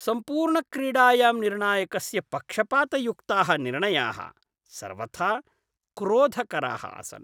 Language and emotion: Sanskrit, disgusted